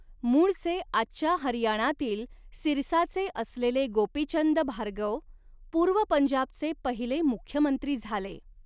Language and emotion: Marathi, neutral